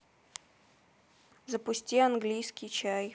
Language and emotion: Russian, neutral